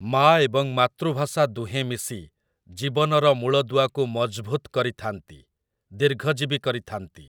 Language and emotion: Odia, neutral